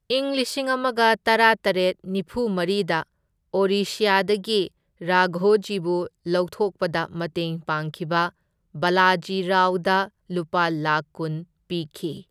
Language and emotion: Manipuri, neutral